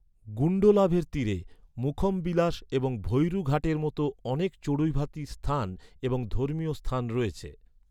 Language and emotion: Bengali, neutral